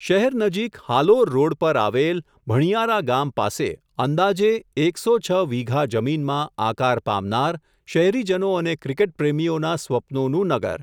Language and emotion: Gujarati, neutral